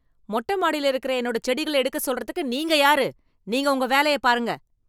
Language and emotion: Tamil, angry